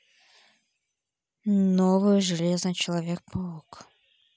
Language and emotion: Russian, neutral